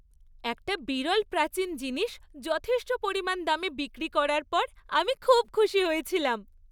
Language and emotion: Bengali, happy